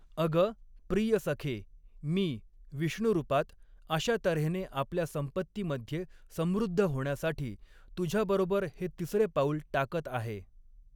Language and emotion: Marathi, neutral